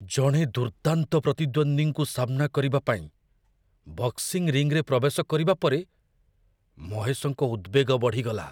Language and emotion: Odia, fearful